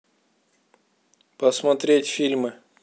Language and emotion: Russian, neutral